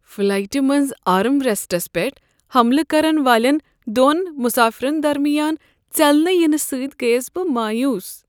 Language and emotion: Kashmiri, sad